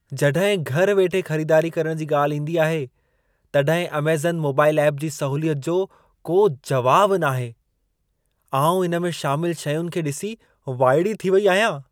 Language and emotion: Sindhi, surprised